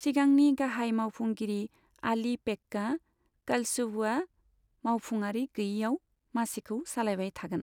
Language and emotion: Bodo, neutral